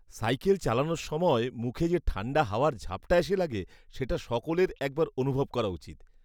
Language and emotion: Bengali, happy